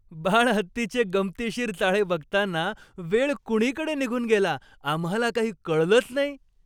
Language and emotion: Marathi, happy